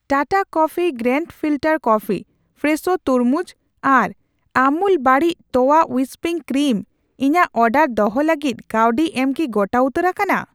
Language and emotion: Santali, neutral